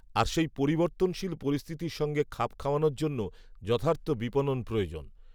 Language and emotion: Bengali, neutral